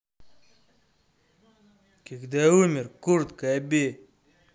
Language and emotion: Russian, angry